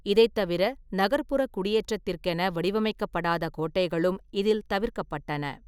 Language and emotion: Tamil, neutral